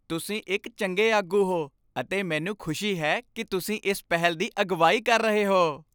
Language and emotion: Punjabi, happy